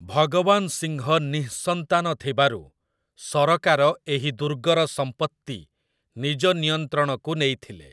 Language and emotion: Odia, neutral